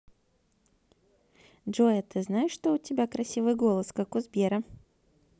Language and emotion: Russian, positive